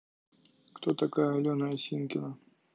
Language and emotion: Russian, neutral